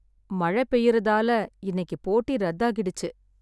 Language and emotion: Tamil, sad